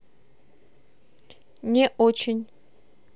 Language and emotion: Russian, neutral